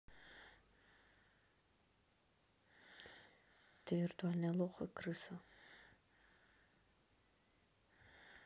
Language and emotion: Russian, neutral